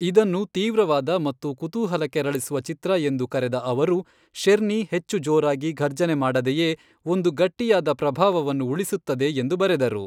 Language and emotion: Kannada, neutral